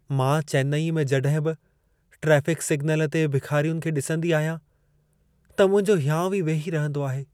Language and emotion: Sindhi, sad